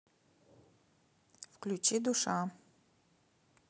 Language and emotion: Russian, neutral